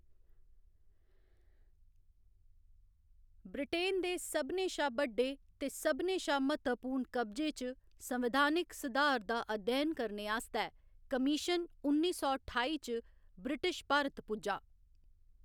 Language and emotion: Dogri, neutral